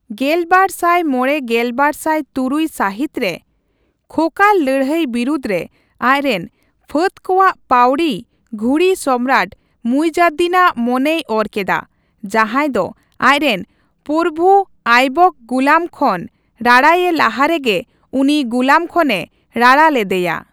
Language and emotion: Santali, neutral